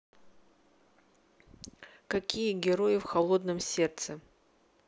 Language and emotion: Russian, neutral